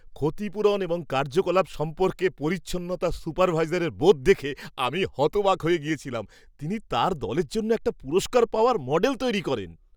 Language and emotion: Bengali, surprised